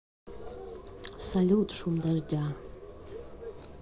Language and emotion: Russian, neutral